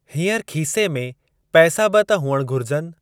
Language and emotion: Sindhi, neutral